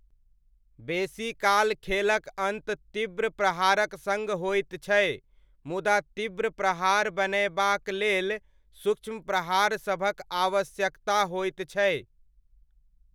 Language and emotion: Maithili, neutral